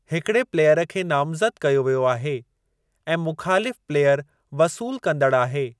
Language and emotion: Sindhi, neutral